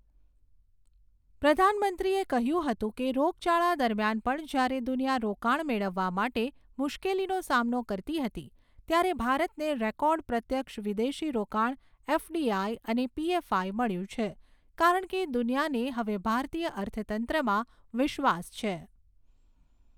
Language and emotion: Gujarati, neutral